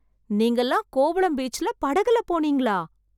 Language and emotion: Tamil, surprised